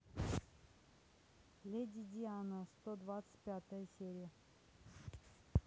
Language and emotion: Russian, neutral